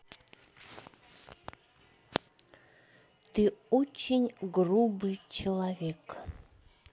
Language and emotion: Russian, neutral